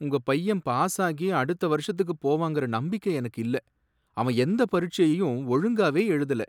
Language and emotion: Tamil, sad